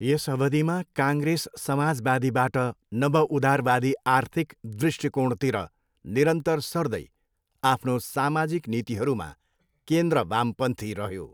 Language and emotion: Nepali, neutral